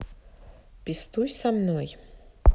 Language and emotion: Russian, neutral